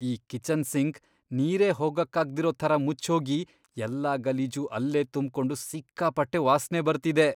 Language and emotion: Kannada, disgusted